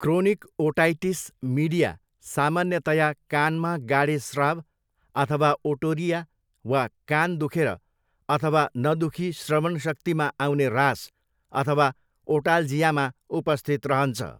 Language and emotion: Nepali, neutral